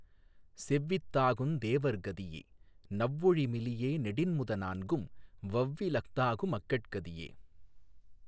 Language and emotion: Tamil, neutral